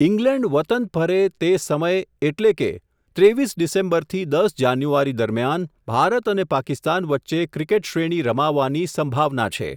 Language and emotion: Gujarati, neutral